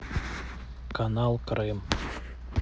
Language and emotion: Russian, neutral